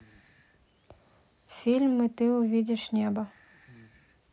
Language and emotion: Russian, neutral